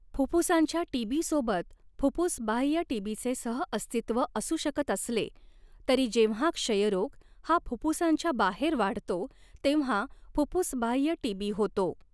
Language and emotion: Marathi, neutral